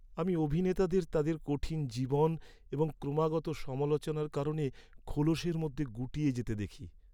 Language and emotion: Bengali, sad